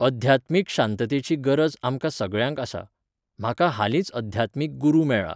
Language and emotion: Goan Konkani, neutral